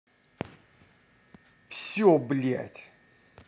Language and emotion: Russian, angry